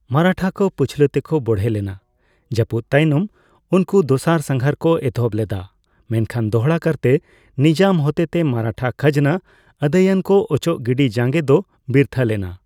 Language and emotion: Santali, neutral